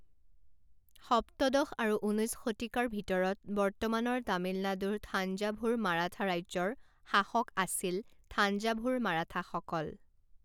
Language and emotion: Assamese, neutral